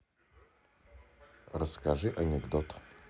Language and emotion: Russian, neutral